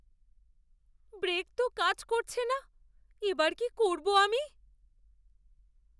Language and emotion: Bengali, fearful